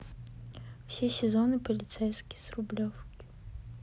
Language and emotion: Russian, neutral